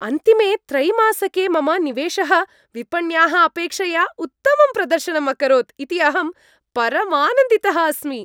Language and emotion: Sanskrit, happy